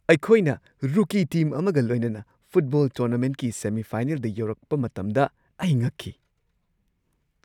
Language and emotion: Manipuri, surprised